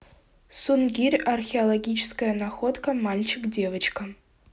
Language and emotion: Russian, neutral